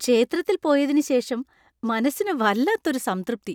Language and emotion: Malayalam, happy